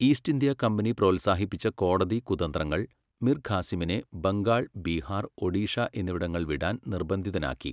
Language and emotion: Malayalam, neutral